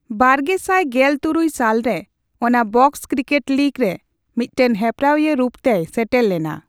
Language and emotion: Santali, neutral